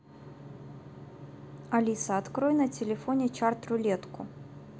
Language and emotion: Russian, neutral